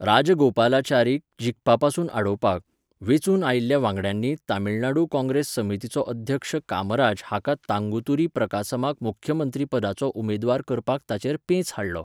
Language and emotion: Goan Konkani, neutral